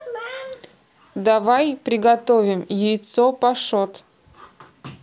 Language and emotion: Russian, neutral